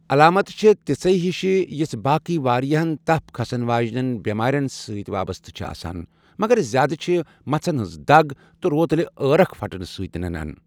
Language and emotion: Kashmiri, neutral